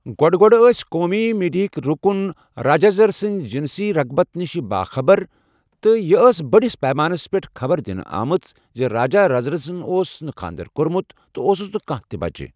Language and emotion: Kashmiri, neutral